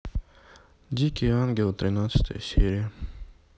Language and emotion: Russian, sad